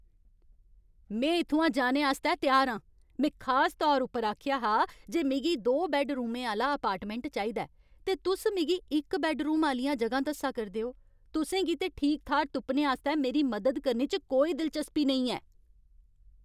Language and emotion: Dogri, angry